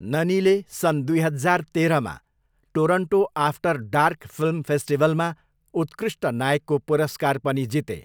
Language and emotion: Nepali, neutral